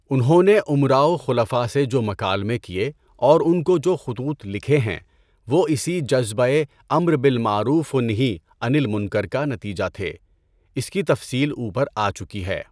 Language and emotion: Urdu, neutral